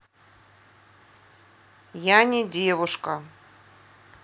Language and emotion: Russian, neutral